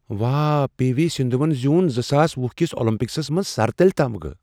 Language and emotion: Kashmiri, surprised